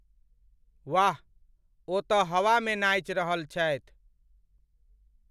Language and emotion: Maithili, neutral